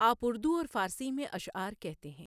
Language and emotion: Urdu, neutral